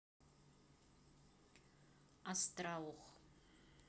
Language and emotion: Russian, neutral